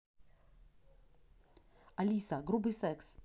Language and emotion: Russian, neutral